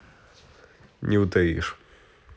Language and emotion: Russian, neutral